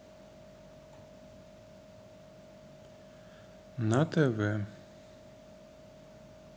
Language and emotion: Russian, neutral